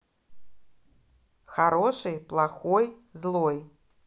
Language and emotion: Russian, positive